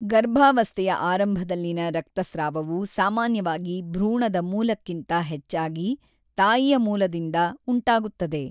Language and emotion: Kannada, neutral